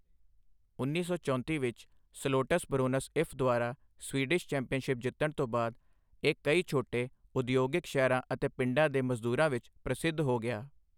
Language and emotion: Punjabi, neutral